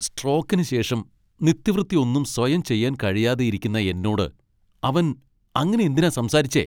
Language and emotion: Malayalam, angry